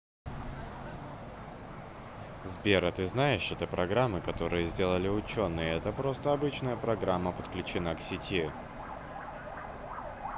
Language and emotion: Russian, neutral